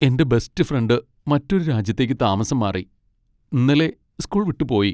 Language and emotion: Malayalam, sad